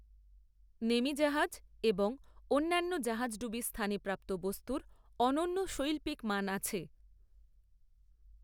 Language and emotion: Bengali, neutral